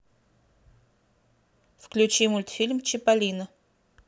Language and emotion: Russian, neutral